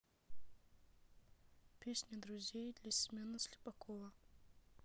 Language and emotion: Russian, neutral